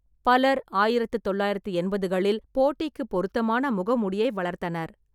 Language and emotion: Tamil, neutral